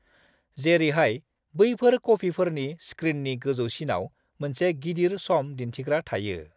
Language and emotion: Bodo, neutral